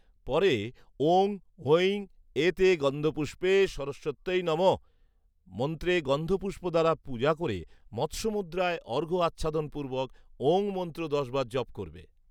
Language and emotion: Bengali, neutral